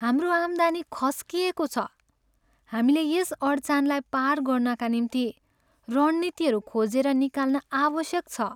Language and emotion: Nepali, sad